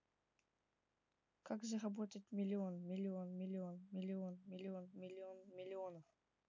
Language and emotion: Russian, neutral